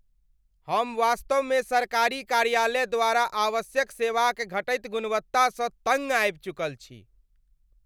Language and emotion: Maithili, angry